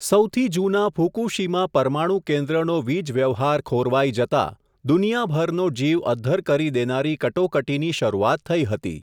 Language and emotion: Gujarati, neutral